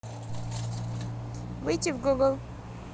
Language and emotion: Russian, neutral